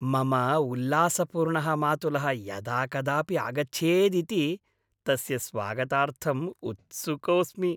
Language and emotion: Sanskrit, happy